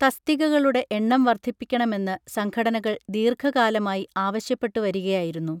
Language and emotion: Malayalam, neutral